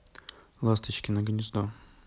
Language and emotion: Russian, neutral